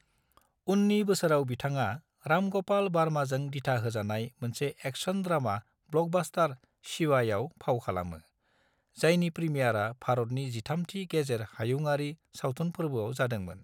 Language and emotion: Bodo, neutral